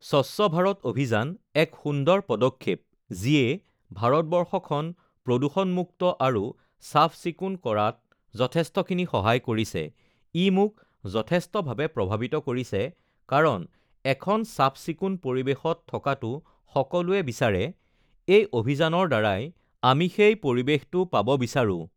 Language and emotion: Assamese, neutral